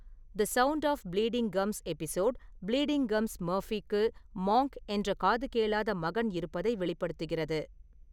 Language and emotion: Tamil, neutral